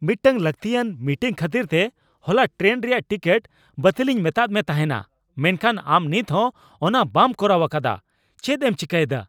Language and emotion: Santali, angry